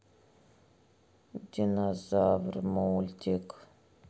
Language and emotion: Russian, sad